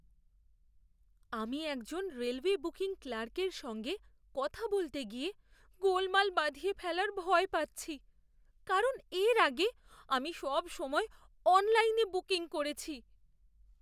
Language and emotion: Bengali, fearful